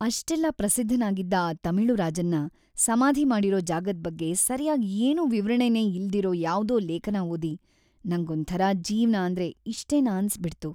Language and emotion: Kannada, sad